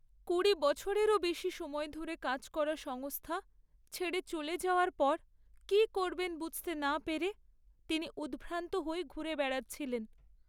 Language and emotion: Bengali, sad